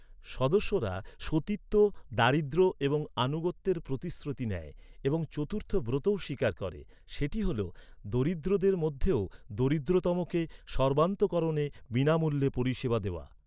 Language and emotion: Bengali, neutral